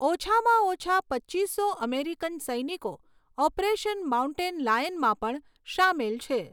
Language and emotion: Gujarati, neutral